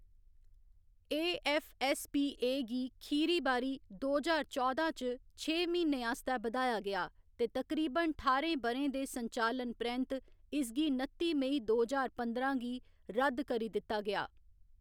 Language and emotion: Dogri, neutral